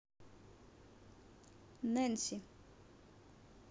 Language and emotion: Russian, neutral